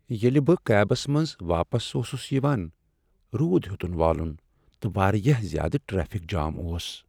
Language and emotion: Kashmiri, sad